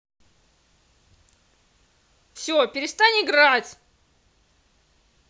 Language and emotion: Russian, angry